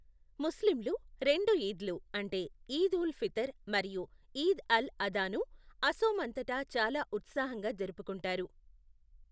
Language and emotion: Telugu, neutral